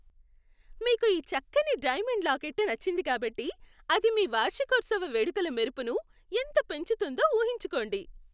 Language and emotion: Telugu, happy